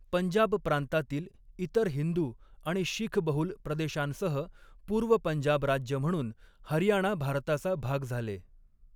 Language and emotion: Marathi, neutral